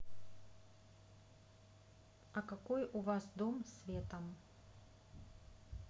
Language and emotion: Russian, neutral